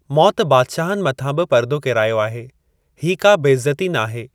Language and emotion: Sindhi, neutral